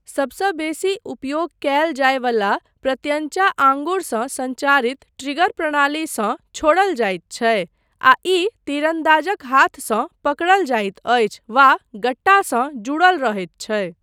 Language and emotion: Maithili, neutral